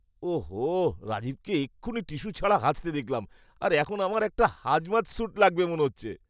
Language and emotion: Bengali, disgusted